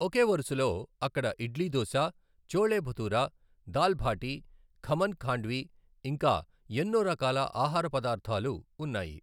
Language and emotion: Telugu, neutral